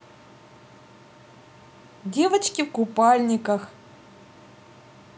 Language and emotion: Russian, positive